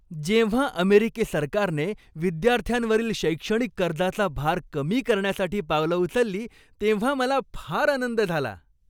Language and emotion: Marathi, happy